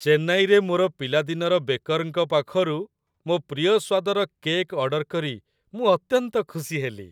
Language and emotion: Odia, happy